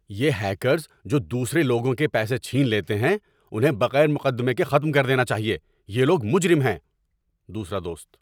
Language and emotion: Urdu, angry